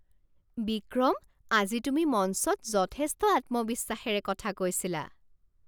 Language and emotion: Assamese, surprised